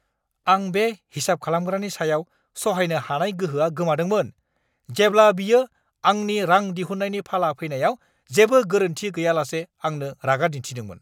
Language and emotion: Bodo, angry